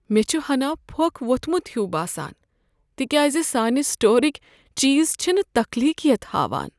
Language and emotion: Kashmiri, sad